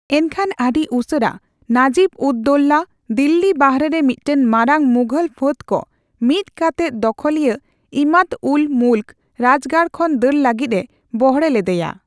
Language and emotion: Santali, neutral